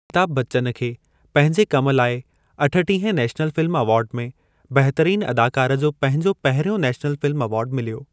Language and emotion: Sindhi, neutral